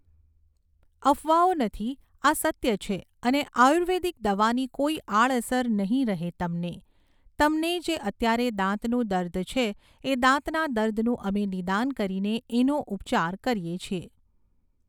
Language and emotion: Gujarati, neutral